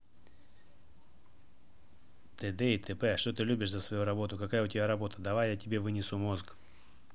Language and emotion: Russian, neutral